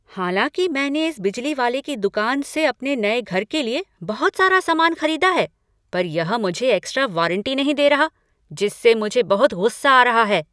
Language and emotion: Hindi, angry